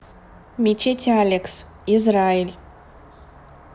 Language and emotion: Russian, neutral